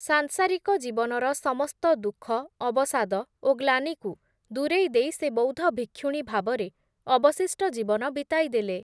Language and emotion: Odia, neutral